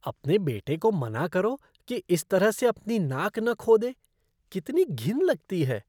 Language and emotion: Hindi, disgusted